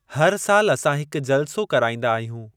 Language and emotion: Sindhi, neutral